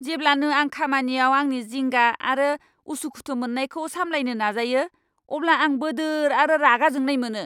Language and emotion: Bodo, angry